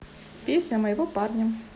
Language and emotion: Russian, neutral